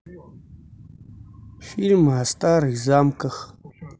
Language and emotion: Russian, neutral